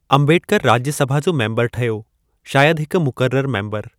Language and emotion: Sindhi, neutral